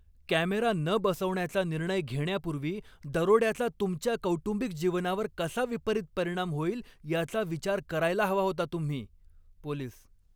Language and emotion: Marathi, angry